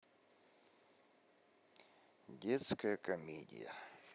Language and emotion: Russian, neutral